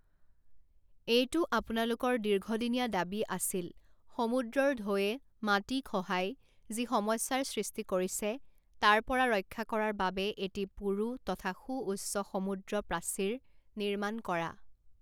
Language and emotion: Assamese, neutral